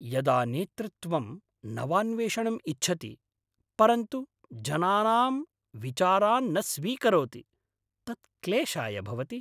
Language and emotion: Sanskrit, angry